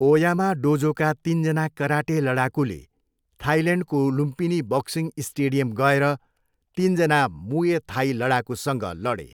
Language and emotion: Nepali, neutral